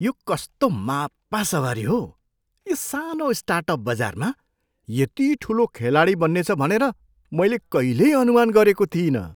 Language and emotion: Nepali, surprised